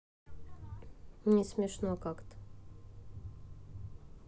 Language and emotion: Russian, sad